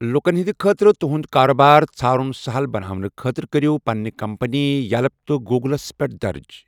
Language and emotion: Kashmiri, neutral